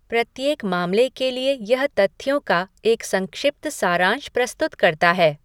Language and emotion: Hindi, neutral